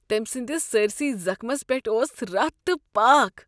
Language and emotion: Kashmiri, disgusted